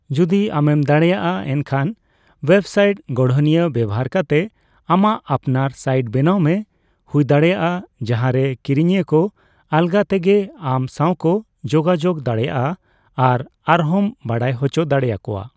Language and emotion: Santali, neutral